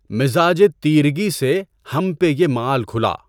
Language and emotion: Urdu, neutral